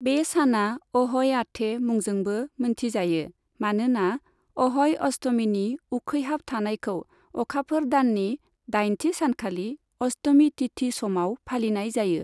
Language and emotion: Bodo, neutral